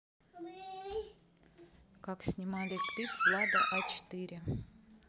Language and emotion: Russian, neutral